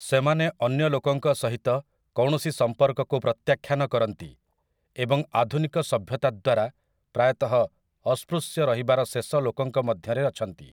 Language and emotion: Odia, neutral